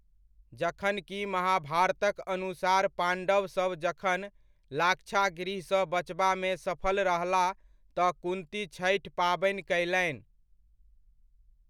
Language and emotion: Maithili, neutral